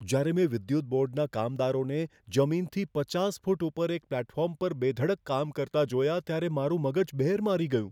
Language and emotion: Gujarati, fearful